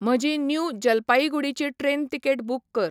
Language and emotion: Goan Konkani, neutral